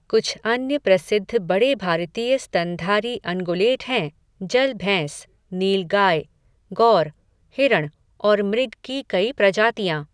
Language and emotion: Hindi, neutral